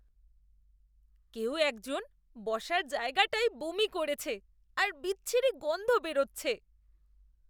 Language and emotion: Bengali, disgusted